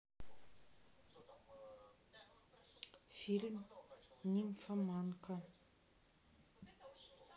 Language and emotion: Russian, neutral